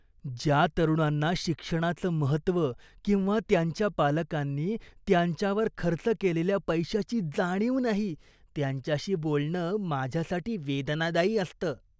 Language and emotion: Marathi, disgusted